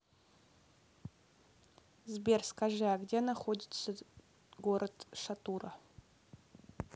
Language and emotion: Russian, neutral